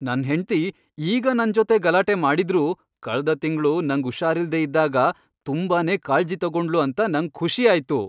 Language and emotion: Kannada, happy